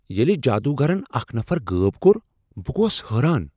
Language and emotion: Kashmiri, surprised